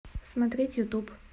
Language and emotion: Russian, neutral